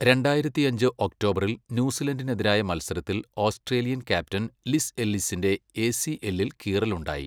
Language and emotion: Malayalam, neutral